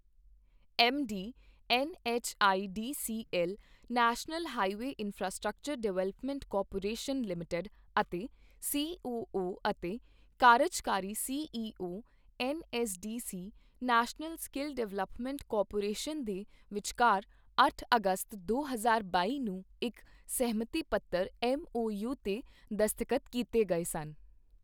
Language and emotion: Punjabi, neutral